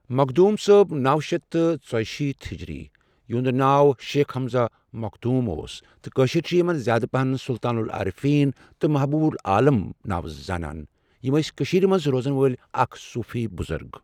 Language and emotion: Kashmiri, neutral